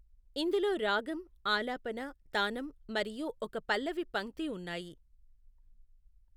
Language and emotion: Telugu, neutral